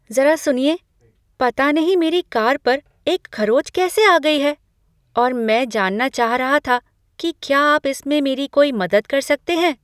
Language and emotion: Hindi, surprised